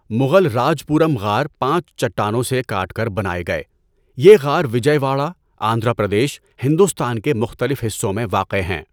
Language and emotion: Urdu, neutral